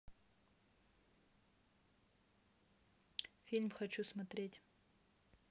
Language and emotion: Russian, neutral